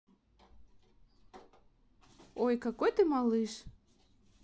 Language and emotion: Russian, positive